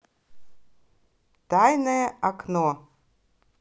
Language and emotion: Russian, positive